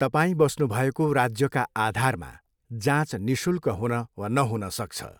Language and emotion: Nepali, neutral